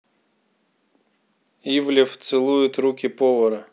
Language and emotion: Russian, neutral